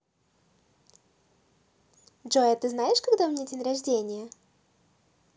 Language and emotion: Russian, positive